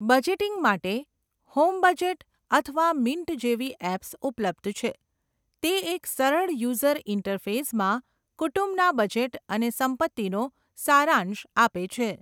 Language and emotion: Gujarati, neutral